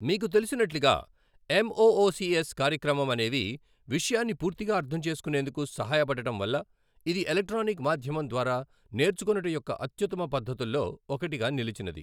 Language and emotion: Telugu, neutral